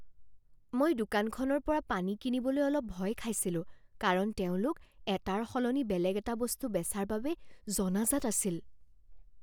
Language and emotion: Assamese, fearful